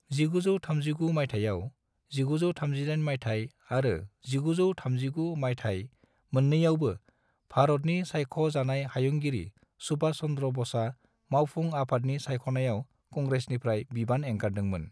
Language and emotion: Bodo, neutral